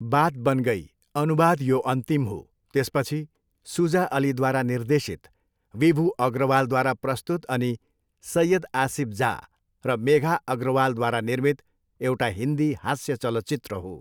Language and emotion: Nepali, neutral